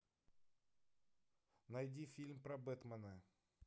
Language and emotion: Russian, neutral